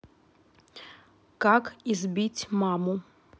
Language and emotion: Russian, neutral